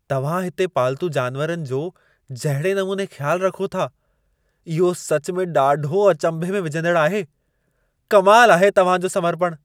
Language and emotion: Sindhi, surprised